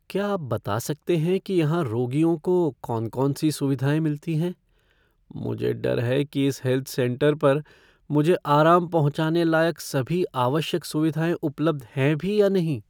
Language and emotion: Hindi, fearful